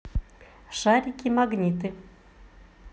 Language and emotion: Russian, positive